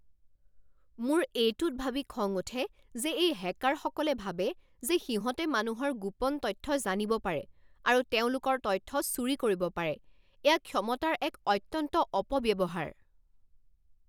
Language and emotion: Assamese, angry